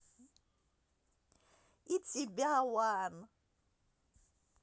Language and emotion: Russian, positive